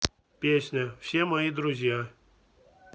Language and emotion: Russian, neutral